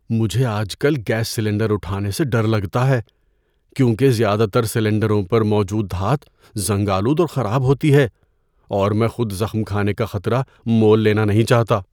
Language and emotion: Urdu, fearful